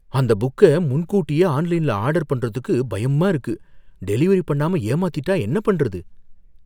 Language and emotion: Tamil, fearful